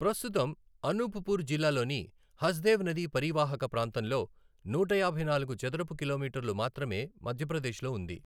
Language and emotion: Telugu, neutral